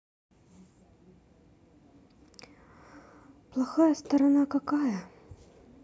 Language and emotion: Russian, sad